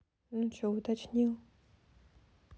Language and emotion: Russian, neutral